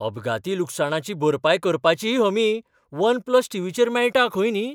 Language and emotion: Goan Konkani, surprised